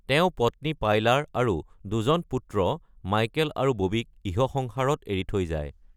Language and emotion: Assamese, neutral